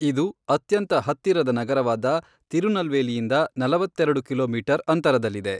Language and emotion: Kannada, neutral